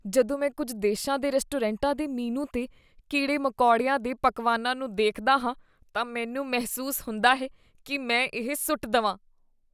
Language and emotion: Punjabi, disgusted